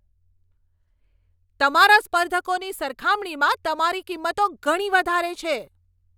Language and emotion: Gujarati, angry